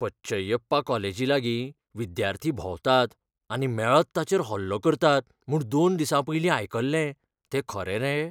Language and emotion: Goan Konkani, fearful